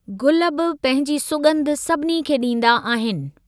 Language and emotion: Sindhi, neutral